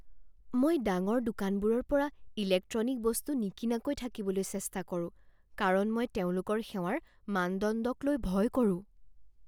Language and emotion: Assamese, fearful